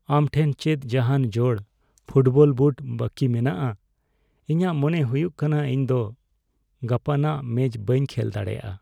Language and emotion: Santali, sad